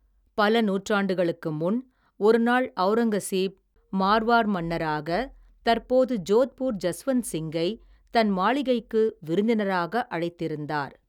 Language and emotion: Tamil, neutral